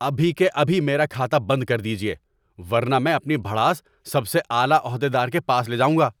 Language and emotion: Urdu, angry